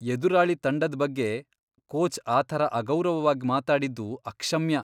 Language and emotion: Kannada, disgusted